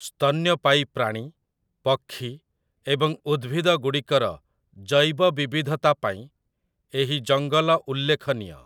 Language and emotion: Odia, neutral